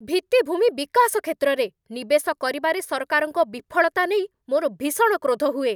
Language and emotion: Odia, angry